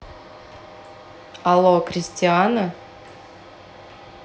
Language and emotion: Russian, neutral